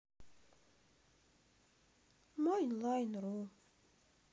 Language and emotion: Russian, sad